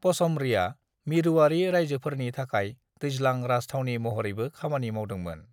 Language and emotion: Bodo, neutral